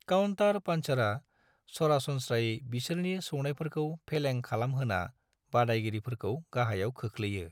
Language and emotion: Bodo, neutral